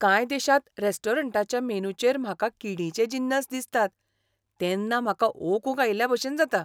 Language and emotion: Goan Konkani, disgusted